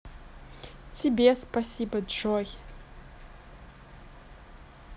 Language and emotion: Russian, neutral